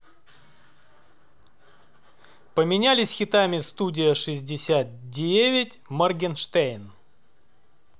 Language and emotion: Russian, neutral